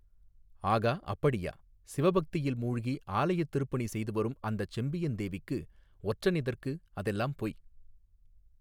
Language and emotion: Tamil, neutral